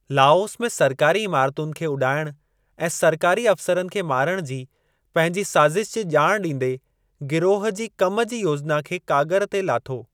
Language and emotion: Sindhi, neutral